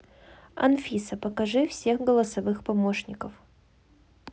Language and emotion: Russian, neutral